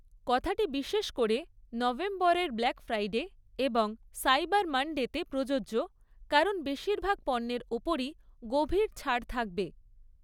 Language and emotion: Bengali, neutral